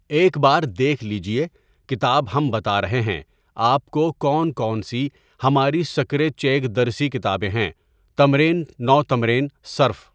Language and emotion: Urdu, neutral